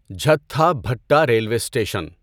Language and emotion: Urdu, neutral